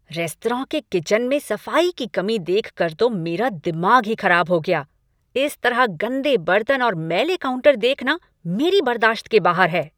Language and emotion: Hindi, angry